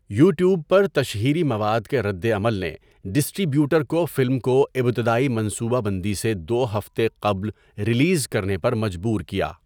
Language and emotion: Urdu, neutral